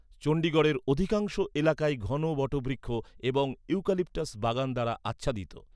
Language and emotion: Bengali, neutral